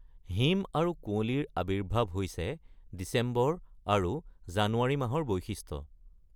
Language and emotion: Assamese, neutral